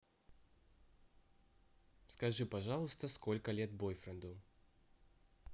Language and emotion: Russian, neutral